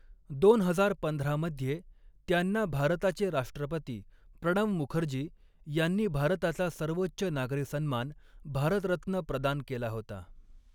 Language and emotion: Marathi, neutral